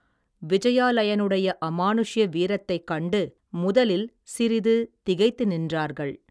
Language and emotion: Tamil, neutral